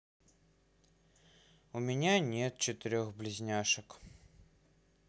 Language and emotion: Russian, sad